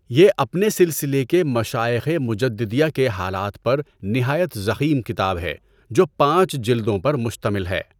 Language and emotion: Urdu, neutral